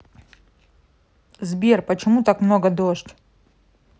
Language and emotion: Russian, neutral